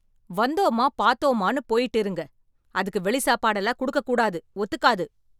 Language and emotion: Tamil, angry